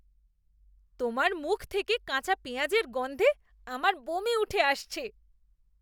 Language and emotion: Bengali, disgusted